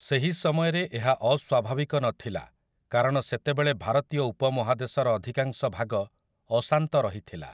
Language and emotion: Odia, neutral